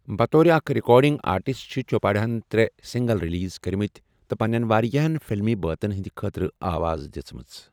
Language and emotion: Kashmiri, neutral